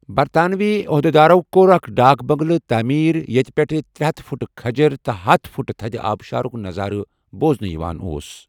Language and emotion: Kashmiri, neutral